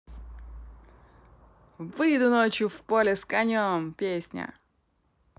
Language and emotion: Russian, positive